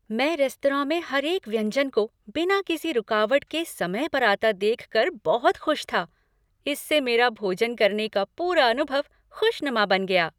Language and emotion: Hindi, happy